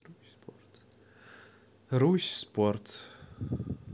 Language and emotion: Russian, neutral